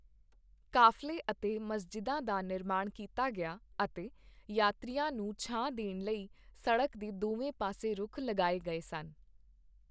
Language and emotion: Punjabi, neutral